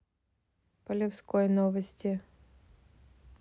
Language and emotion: Russian, neutral